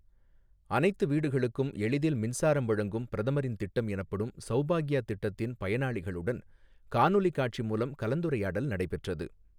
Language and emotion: Tamil, neutral